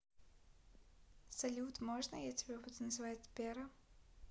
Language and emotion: Russian, neutral